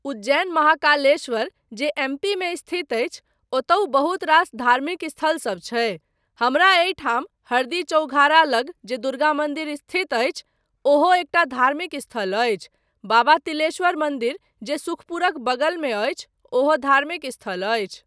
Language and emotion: Maithili, neutral